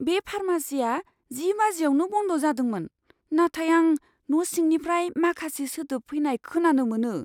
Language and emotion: Bodo, fearful